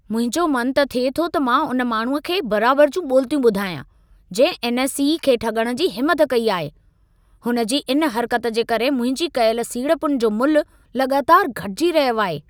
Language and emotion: Sindhi, angry